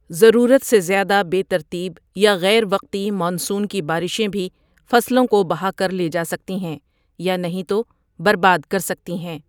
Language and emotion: Urdu, neutral